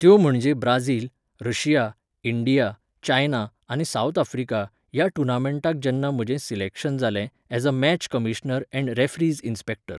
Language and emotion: Goan Konkani, neutral